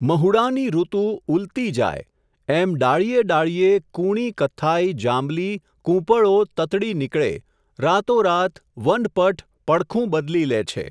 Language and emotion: Gujarati, neutral